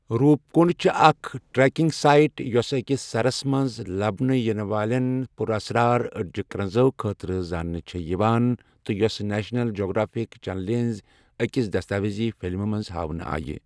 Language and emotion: Kashmiri, neutral